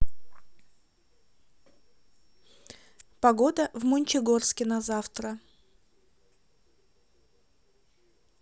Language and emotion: Russian, neutral